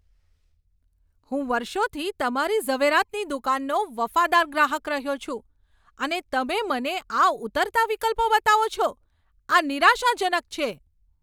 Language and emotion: Gujarati, angry